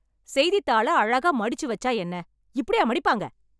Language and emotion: Tamil, angry